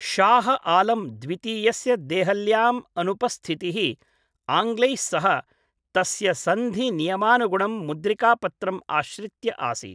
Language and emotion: Sanskrit, neutral